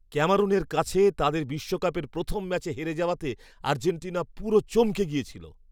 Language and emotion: Bengali, surprised